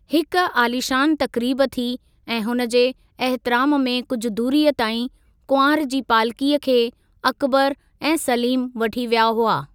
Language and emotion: Sindhi, neutral